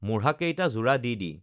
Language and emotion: Assamese, neutral